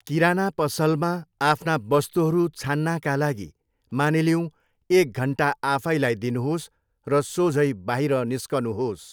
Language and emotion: Nepali, neutral